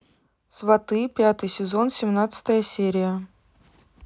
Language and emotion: Russian, neutral